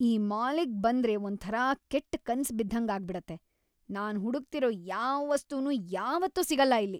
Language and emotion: Kannada, angry